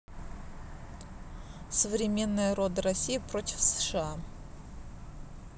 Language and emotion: Russian, neutral